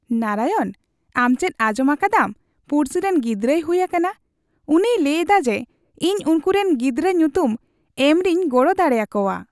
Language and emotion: Santali, happy